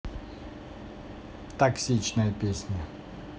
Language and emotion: Russian, neutral